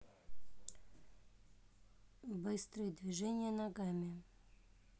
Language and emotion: Russian, neutral